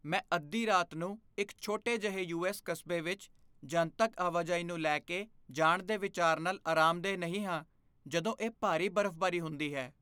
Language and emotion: Punjabi, fearful